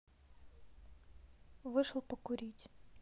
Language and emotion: Russian, neutral